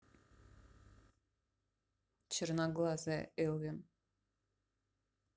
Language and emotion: Russian, neutral